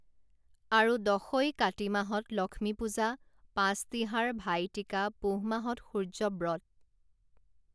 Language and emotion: Assamese, neutral